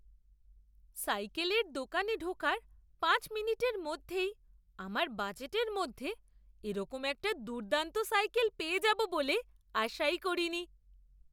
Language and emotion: Bengali, surprised